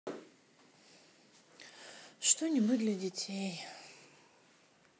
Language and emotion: Russian, sad